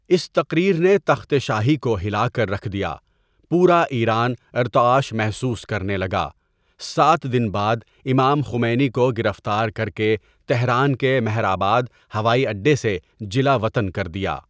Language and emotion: Urdu, neutral